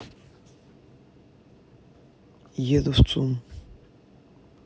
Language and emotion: Russian, neutral